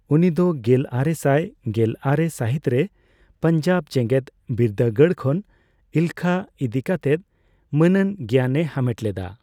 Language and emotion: Santali, neutral